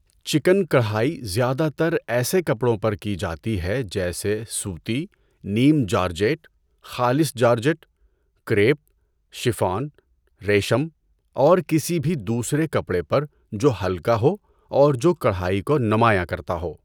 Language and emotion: Urdu, neutral